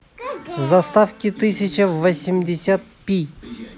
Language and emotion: Russian, positive